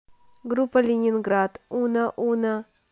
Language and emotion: Russian, neutral